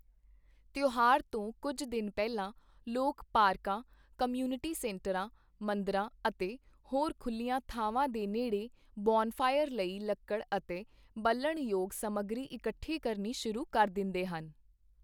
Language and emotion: Punjabi, neutral